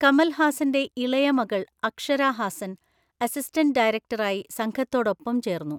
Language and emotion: Malayalam, neutral